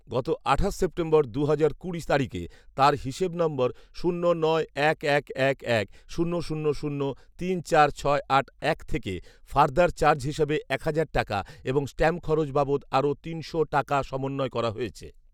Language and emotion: Bengali, neutral